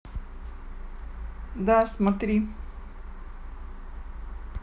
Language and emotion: Russian, neutral